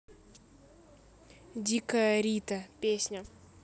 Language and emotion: Russian, neutral